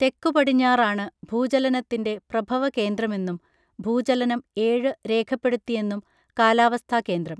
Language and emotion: Malayalam, neutral